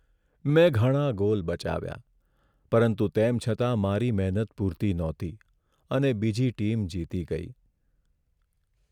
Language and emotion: Gujarati, sad